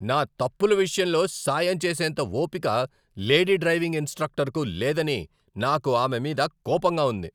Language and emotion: Telugu, angry